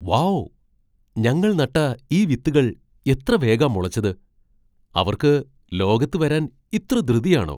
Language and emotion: Malayalam, surprised